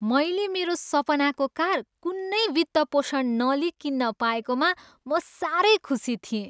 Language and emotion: Nepali, happy